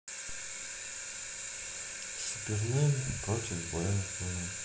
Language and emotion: Russian, sad